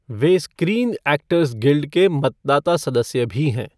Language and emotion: Hindi, neutral